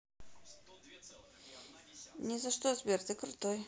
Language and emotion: Russian, neutral